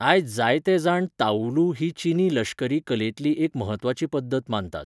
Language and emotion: Goan Konkani, neutral